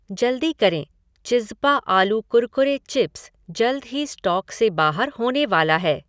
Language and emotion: Hindi, neutral